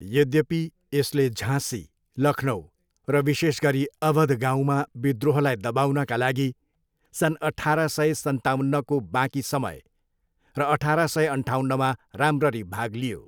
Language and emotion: Nepali, neutral